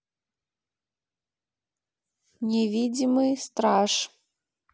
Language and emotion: Russian, neutral